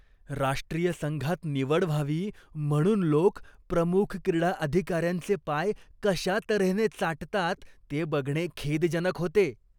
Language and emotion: Marathi, disgusted